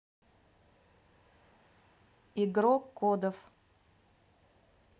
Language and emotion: Russian, neutral